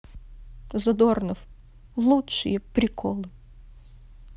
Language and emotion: Russian, sad